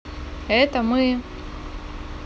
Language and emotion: Russian, neutral